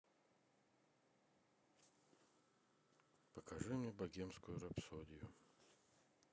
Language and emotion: Russian, sad